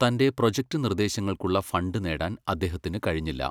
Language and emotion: Malayalam, neutral